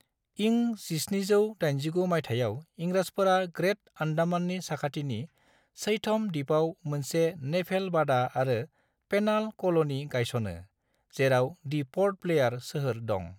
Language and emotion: Bodo, neutral